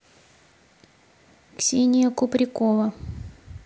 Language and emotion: Russian, neutral